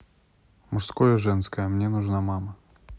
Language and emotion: Russian, neutral